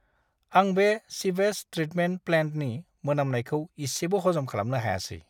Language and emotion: Bodo, disgusted